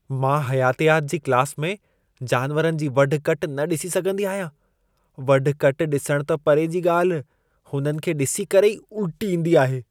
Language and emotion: Sindhi, disgusted